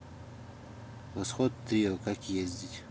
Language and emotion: Russian, neutral